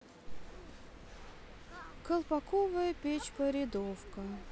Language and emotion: Russian, sad